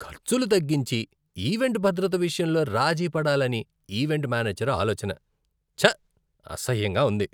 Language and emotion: Telugu, disgusted